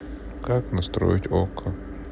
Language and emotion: Russian, sad